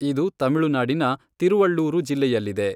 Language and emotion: Kannada, neutral